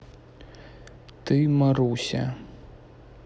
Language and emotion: Russian, neutral